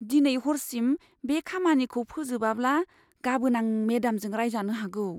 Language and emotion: Bodo, fearful